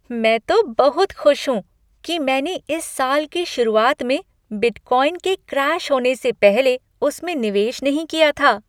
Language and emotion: Hindi, happy